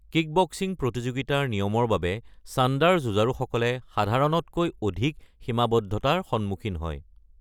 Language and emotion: Assamese, neutral